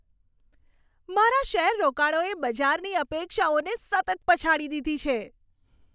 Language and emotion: Gujarati, happy